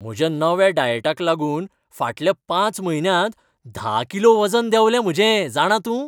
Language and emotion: Goan Konkani, happy